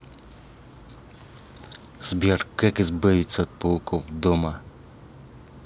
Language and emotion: Russian, angry